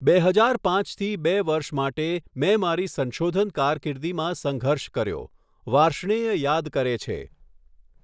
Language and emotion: Gujarati, neutral